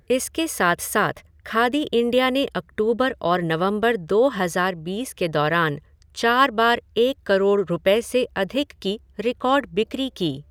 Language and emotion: Hindi, neutral